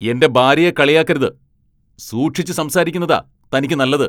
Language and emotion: Malayalam, angry